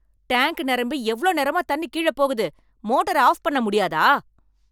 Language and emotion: Tamil, angry